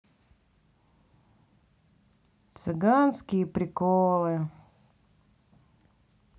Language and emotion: Russian, neutral